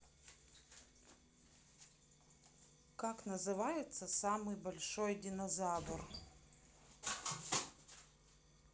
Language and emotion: Russian, neutral